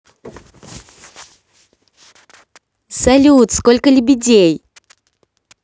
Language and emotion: Russian, positive